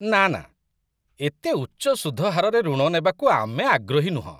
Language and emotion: Odia, disgusted